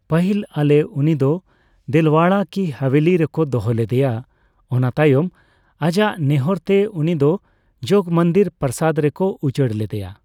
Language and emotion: Santali, neutral